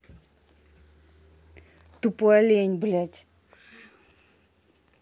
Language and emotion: Russian, angry